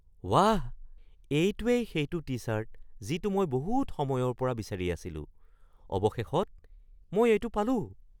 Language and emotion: Assamese, surprised